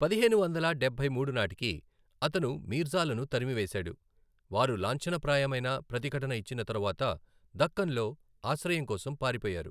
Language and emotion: Telugu, neutral